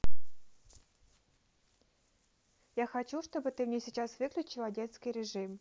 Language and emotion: Russian, neutral